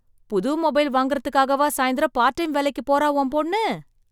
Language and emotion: Tamil, surprised